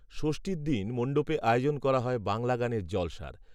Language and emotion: Bengali, neutral